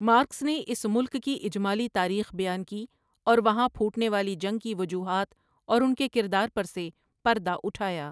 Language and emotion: Urdu, neutral